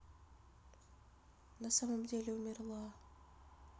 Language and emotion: Russian, sad